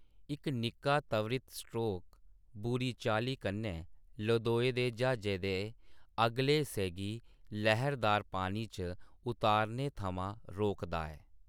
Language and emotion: Dogri, neutral